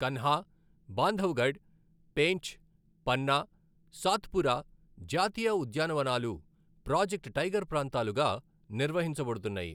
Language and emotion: Telugu, neutral